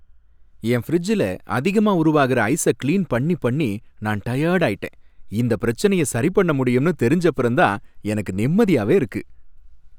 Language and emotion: Tamil, happy